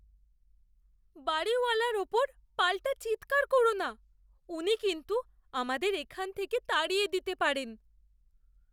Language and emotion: Bengali, fearful